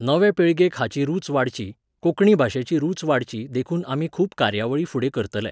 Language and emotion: Goan Konkani, neutral